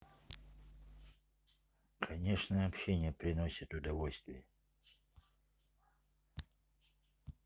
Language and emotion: Russian, neutral